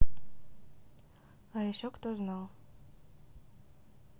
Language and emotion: Russian, neutral